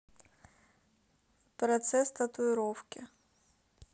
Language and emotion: Russian, neutral